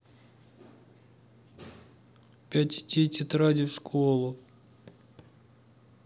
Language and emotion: Russian, sad